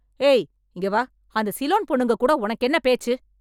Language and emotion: Tamil, angry